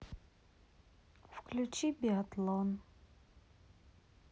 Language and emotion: Russian, sad